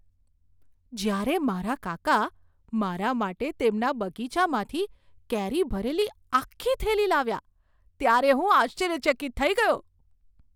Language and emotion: Gujarati, surprised